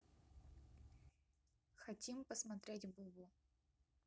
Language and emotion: Russian, neutral